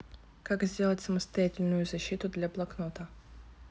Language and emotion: Russian, neutral